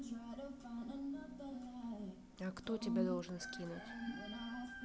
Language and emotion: Russian, neutral